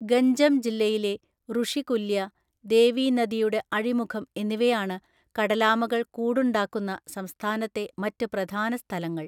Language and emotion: Malayalam, neutral